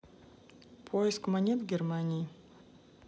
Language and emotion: Russian, neutral